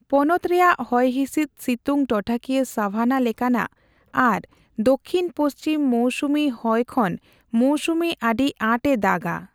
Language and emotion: Santali, neutral